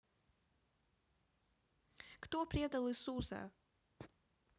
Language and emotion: Russian, neutral